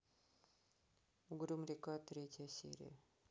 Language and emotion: Russian, neutral